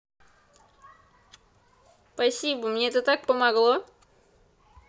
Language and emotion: Russian, positive